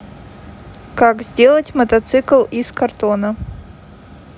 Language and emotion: Russian, neutral